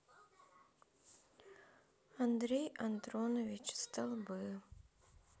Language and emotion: Russian, sad